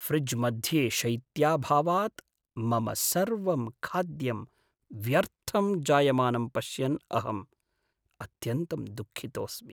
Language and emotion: Sanskrit, sad